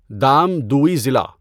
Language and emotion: Urdu, neutral